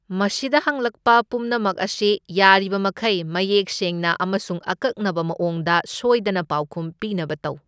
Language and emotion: Manipuri, neutral